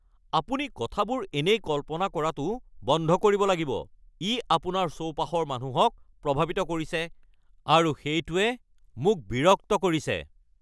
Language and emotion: Assamese, angry